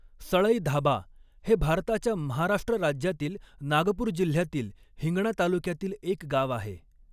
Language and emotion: Marathi, neutral